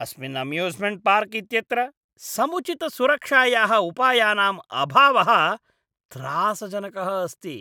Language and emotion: Sanskrit, disgusted